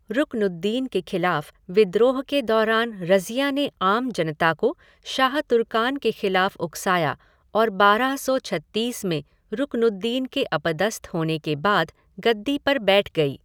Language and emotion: Hindi, neutral